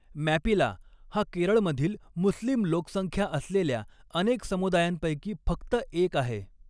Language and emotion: Marathi, neutral